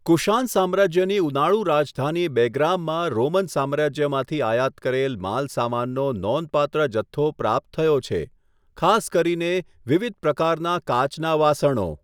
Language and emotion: Gujarati, neutral